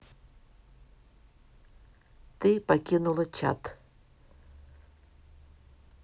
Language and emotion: Russian, neutral